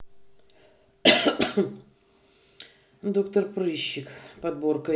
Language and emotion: Russian, neutral